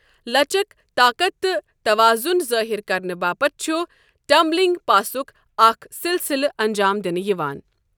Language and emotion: Kashmiri, neutral